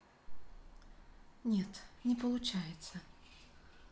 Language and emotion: Russian, sad